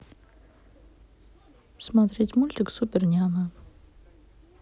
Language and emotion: Russian, neutral